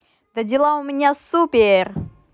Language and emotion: Russian, positive